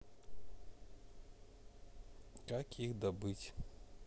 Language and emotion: Russian, neutral